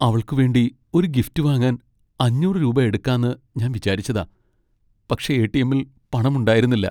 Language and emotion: Malayalam, sad